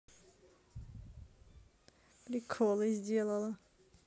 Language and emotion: Russian, neutral